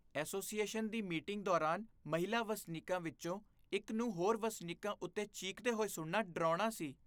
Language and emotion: Punjabi, disgusted